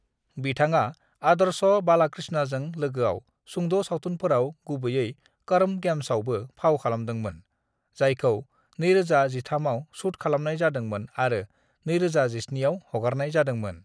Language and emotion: Bodo, neutral